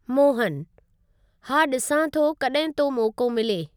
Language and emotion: Sindhi, neutral